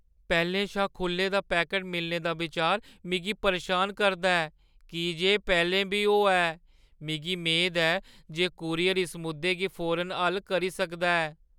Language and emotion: Dogri, fearful